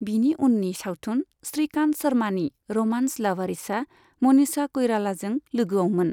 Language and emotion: Bodo, neutral